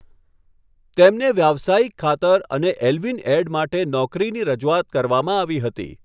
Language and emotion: Gujarati, neutral